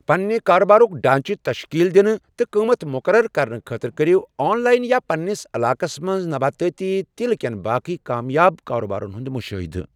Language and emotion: Kashmiri, neutral